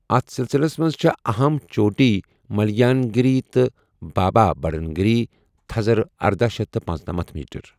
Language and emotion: Kashmiri, neutral